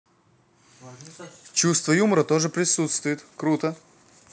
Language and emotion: Russian, positive